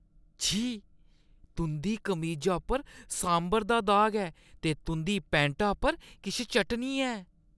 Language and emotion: Dogri, disgusted